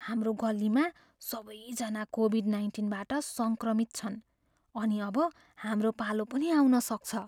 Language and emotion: Nepali, fearful